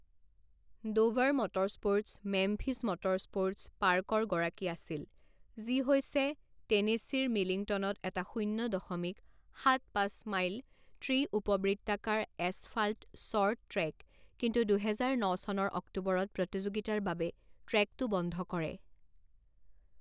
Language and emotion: Assamese, neutral